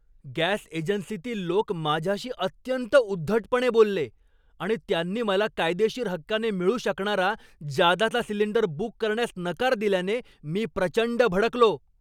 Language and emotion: Marathi, angry